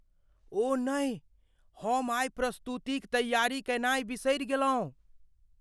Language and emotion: Maithili, fearful